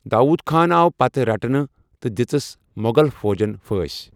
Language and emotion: Kashmiri, neutral